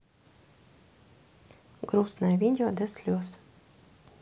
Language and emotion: Russian, neutral